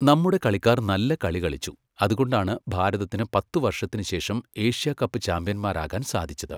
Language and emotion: Malayalam, neutral